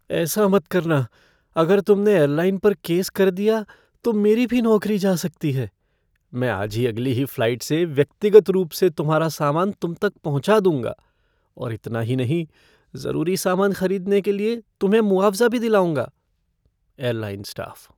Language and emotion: Hindi, fearful